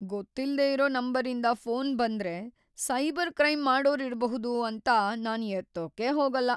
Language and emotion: Kannada, fearful